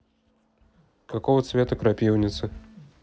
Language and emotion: Russian, neutral